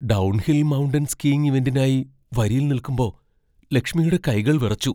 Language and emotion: Malayalam, fearful